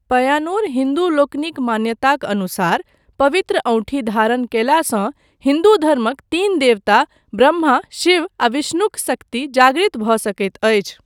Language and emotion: Maithili, neutral